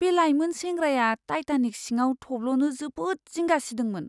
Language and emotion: Bodo, fearful